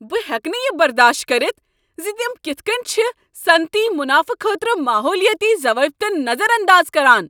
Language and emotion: Kashmiri, angry